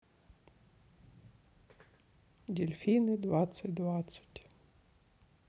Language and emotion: Russian, sad